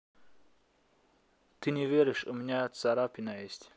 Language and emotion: Russian, neutral